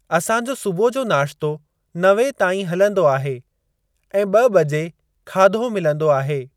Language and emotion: Sindhi, neutral